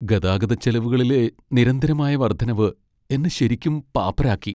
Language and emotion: Malayalam, sad